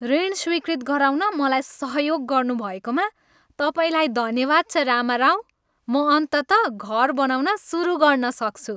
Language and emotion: Nepali, happy